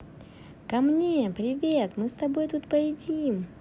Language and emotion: Russian, positive